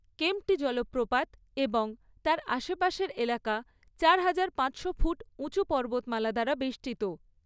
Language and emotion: Bengali, neutral